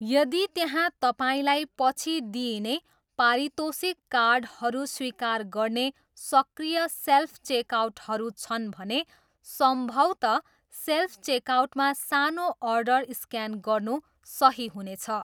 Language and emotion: Nepali, neutral